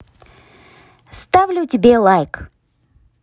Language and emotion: Russian, positive